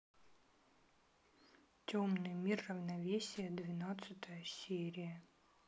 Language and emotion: Russian, sad